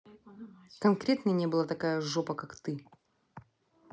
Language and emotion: Russian, angry